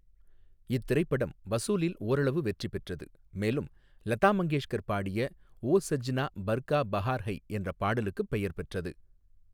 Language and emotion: Tamil, neutral